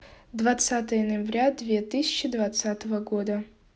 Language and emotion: Russian, neutral